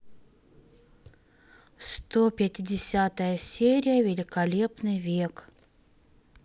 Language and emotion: Russian, neutral